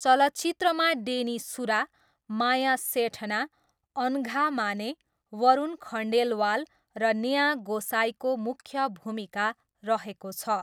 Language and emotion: Nepali, neutral